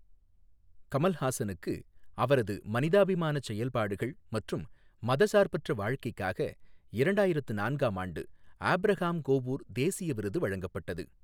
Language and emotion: Tamil, neutral